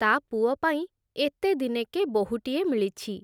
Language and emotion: Odia, neutral